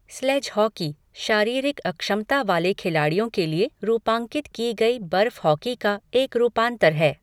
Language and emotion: Hindi, neutral